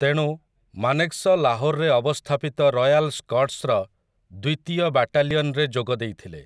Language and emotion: Odia, neutral